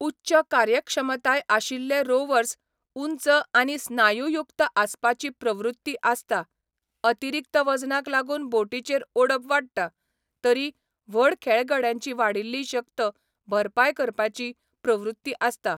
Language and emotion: Goan Konkani, neutral